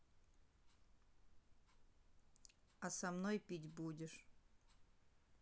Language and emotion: Russian, neutral